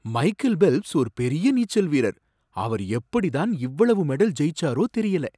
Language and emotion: Tamil, surprised